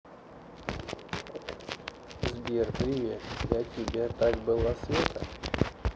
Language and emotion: Russian, neutral